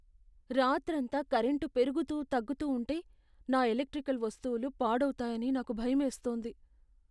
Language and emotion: Telugu, fearful